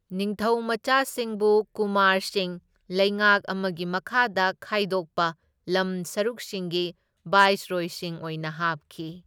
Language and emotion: Manipuri, neutral